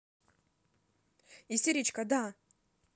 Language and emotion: Russian, angry